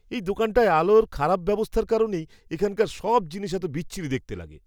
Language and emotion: Bengali, disgusted